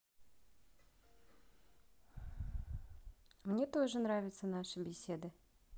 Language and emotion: Russian, positive